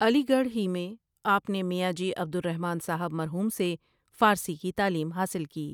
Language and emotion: Urdu, neutral